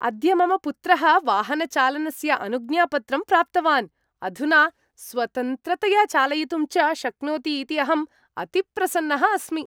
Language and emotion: Sanskrit, happy